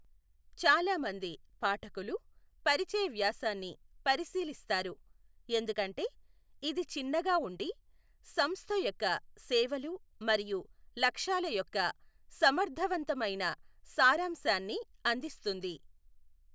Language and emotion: Telugu, neutral